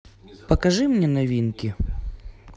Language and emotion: Russian, neutral